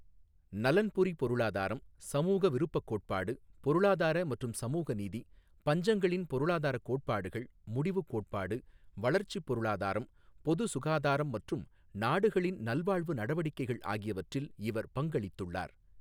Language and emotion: Tamil, neutral